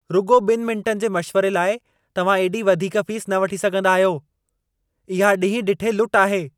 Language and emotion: Sindhi, angry